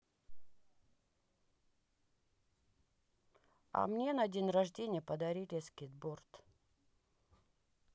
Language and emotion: Russian, sad